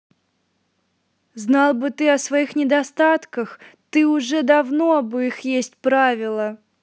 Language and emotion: Russian, angry